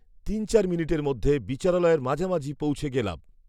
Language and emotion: Bengali, neutral